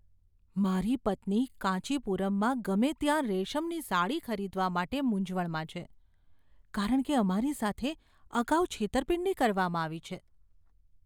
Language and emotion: Gujarati, fearful